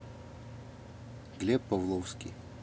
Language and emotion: Russian, neutral